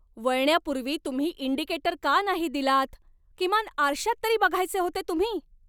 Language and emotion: Marathi, angry